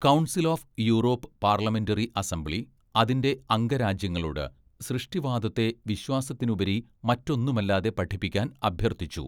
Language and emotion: Malayalam, neutral